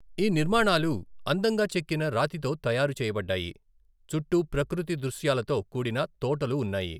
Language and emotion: Telugu, neutral